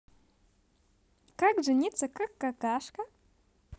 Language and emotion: Russian, positive